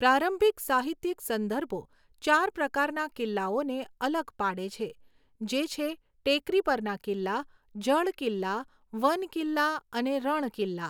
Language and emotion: Gujarati, neutral